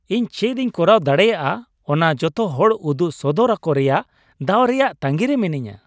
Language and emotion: Santali, happy